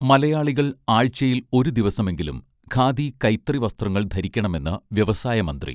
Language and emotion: Malayalam, neutral